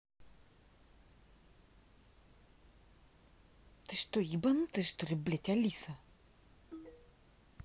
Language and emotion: Russian, angry